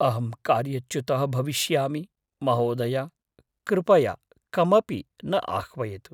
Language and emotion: Sanskrit, fearful